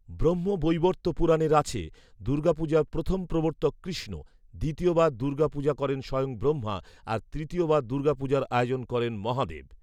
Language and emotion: Bengali, neutral